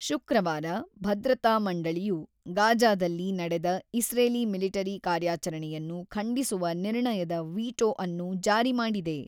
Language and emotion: Kannada, neutral